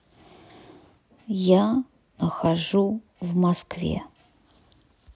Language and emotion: Russian, neutral